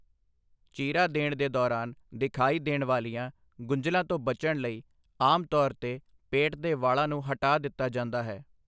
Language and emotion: Punjabi, neutral